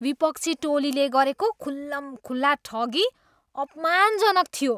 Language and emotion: Nepali, disgusted